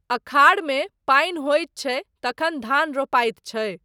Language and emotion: Maithili, neutral